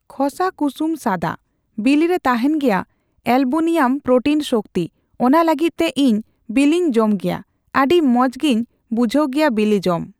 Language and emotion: Santali, neutral